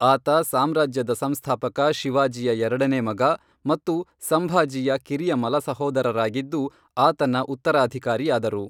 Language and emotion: Kannada, neutral